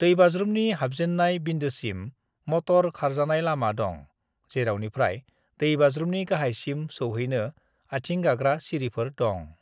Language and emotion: Bodo, neutral